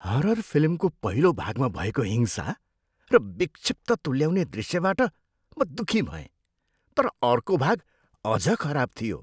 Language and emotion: Nepali, disgusted